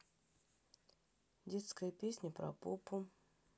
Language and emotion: Russian, neutral